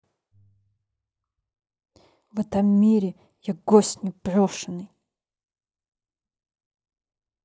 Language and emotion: Russian, angry